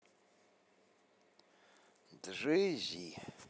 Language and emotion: Russian, neutral